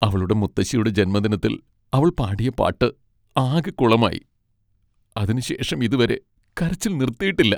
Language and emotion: Malayalam, sad